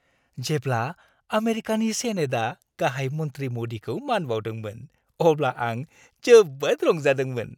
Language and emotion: Bodo, happy